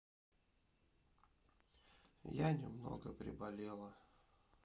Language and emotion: Russian, sad